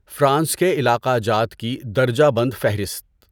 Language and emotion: Urdu, neutral